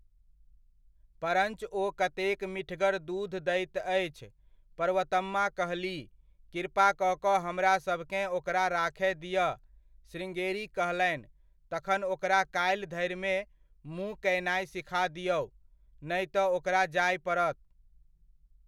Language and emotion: Maithili, neutral